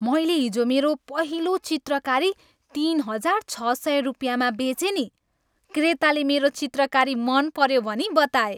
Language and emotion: Nepali, happy